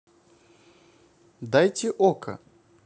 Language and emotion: Russian, neutral